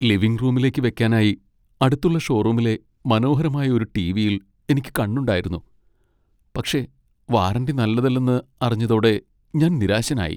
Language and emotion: Malayalam, sad